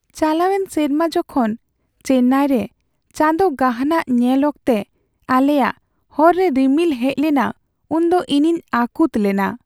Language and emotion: Santali, sad